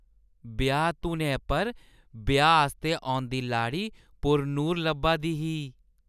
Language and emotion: Dogri, happy